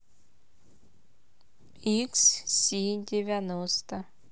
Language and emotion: Russian, neutral